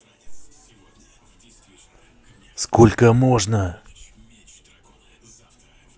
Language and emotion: Russian, angry